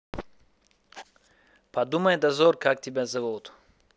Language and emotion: Russian, neutral